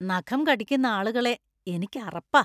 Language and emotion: Malayalam, disgusted